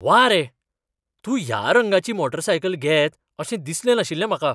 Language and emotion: Goan Konkani, surprised